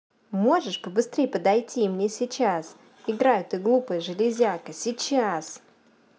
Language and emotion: Russian, angry